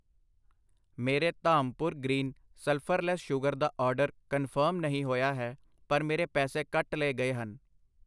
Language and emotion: Punjabi, neutral